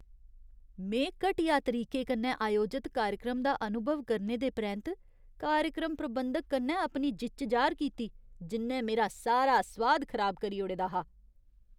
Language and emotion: Dogri, disgusted